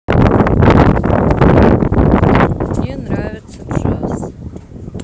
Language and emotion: Russian, neutral